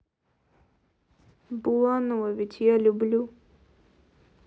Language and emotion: Russian, sad